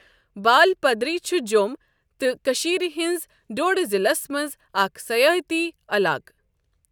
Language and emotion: Kashmiri, neutral